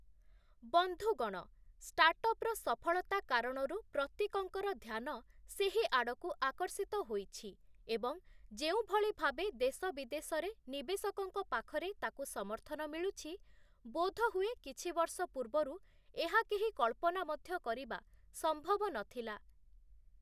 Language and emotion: Odia, neutral